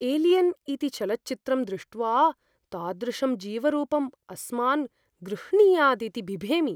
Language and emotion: Sanskrit, fearful